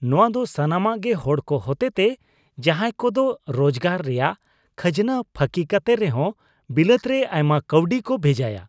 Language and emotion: Santali, disgusted